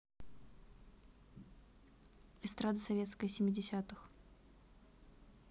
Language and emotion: Russian, neutral